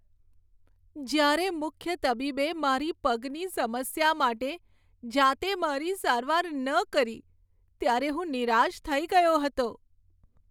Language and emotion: Gujarati, sad